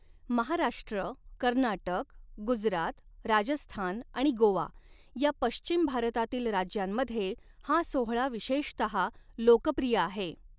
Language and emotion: Marathi, neutral